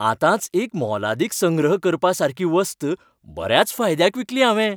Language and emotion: Goan Konkani, happy